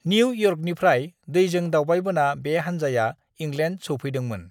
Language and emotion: Bodo, neutral